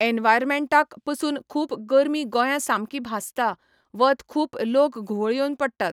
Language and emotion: Goan Konkani, neutral